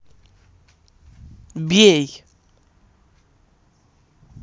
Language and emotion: Russian, angry